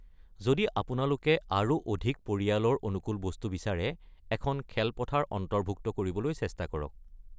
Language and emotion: Assamese, neutral